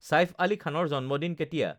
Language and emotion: Assamese, neutral